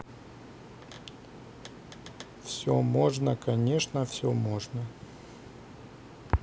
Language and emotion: Russian, neutral